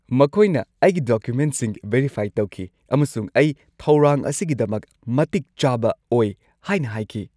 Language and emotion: Manipuri, happy